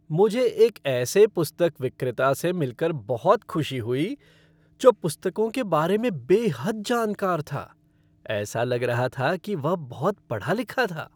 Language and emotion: Hindi, happy